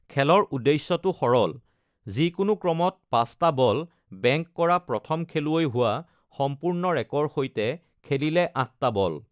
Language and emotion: Assamese, neutral